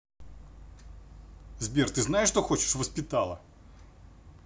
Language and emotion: Russian, angry